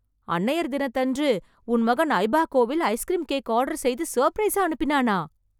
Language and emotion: Tamil, surprised